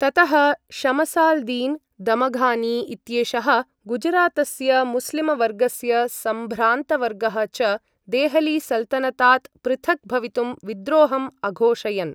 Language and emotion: Sanskrit, neutral